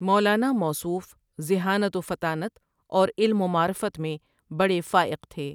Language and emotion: Urdu, neutral